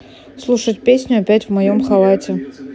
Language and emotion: Russian, neutral